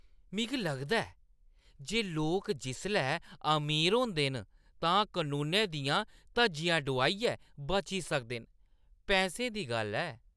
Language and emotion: Dogri, disgusted